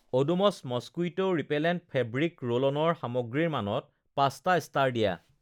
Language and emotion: Assamese, neutral